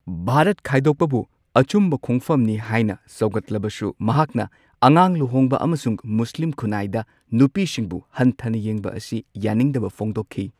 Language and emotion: Manipuri, neutral